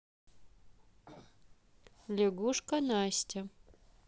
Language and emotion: Russian, neutral